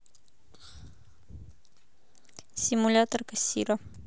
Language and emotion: Russian, neutral